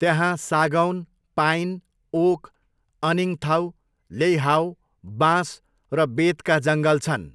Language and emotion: Nepali, neutral